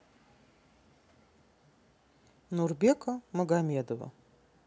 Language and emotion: Russian, neutral